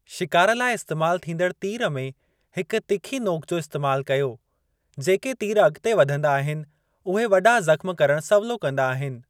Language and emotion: Sindhi, neutral